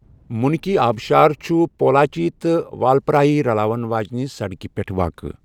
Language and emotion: Kashmiri, neutral